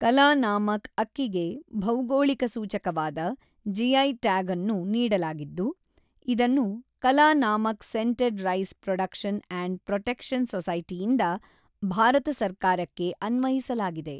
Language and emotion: Kannada, neutral